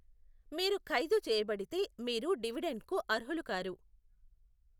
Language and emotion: Telugu, neutral